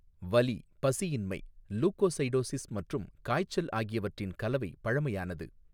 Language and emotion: Tamil, neutral